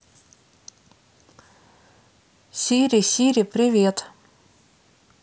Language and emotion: Russian, neutral